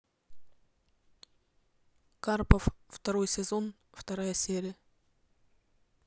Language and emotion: Russian, neutral